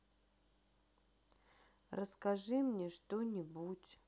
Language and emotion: Russian, sad